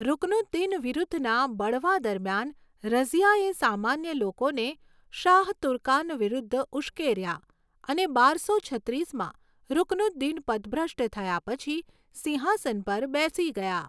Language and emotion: Gujarati, neutral